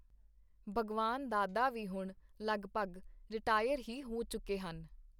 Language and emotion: Punjabi, neutral